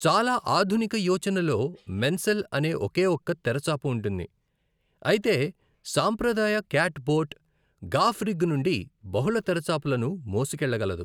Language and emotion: Telugu, neutral